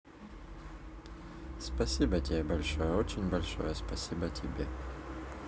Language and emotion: Russian, neutral